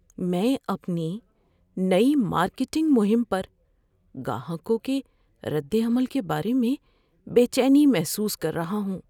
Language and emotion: Urdu, fearful